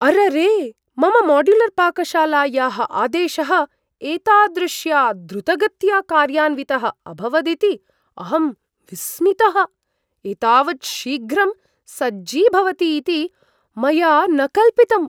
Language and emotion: Sanskrit, surprised